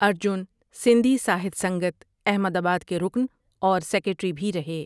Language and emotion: Urdu, neutral